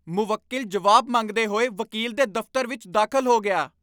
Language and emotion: Punjabi, angry